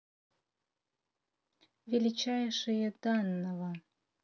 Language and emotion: Russian, neutral